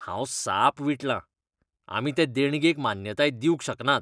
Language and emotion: Goan Konkani, disgusted